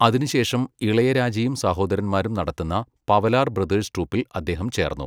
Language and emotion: Malayalam, neutral